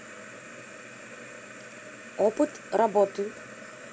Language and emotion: Russian, neutral